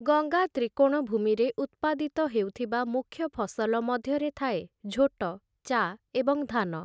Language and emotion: Odia, neutral